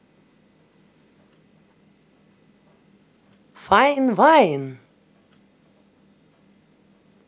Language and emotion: Russian, positive